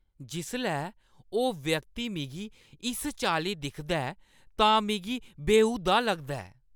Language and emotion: Dogri, disgusted